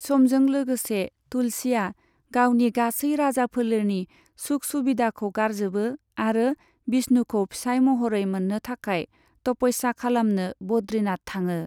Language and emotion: Bodo, neutral